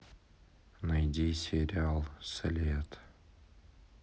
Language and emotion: Russian, sad